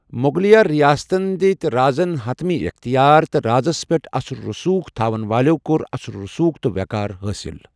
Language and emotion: Kashmiri, neutral